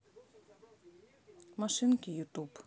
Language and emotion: Russian, neutral